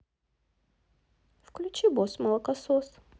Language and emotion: Russian, neutral